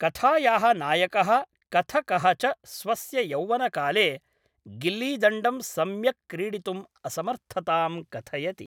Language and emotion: Sanskrit, neutral